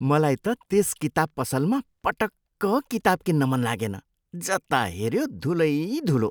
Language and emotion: Nepali, disgusted